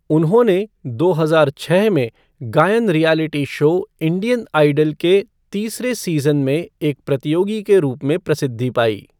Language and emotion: Hindi, neutral